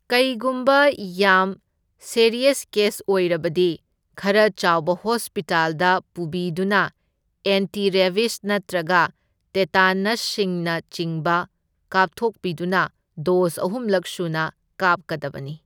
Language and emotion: Manipuri, neutral